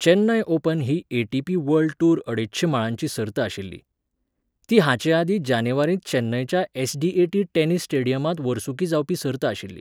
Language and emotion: Goan Konkani, neutral